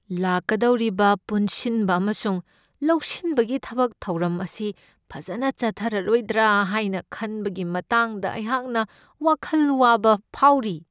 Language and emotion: Manipuri, fearful